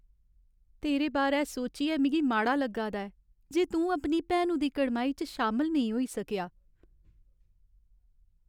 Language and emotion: Dogri, sad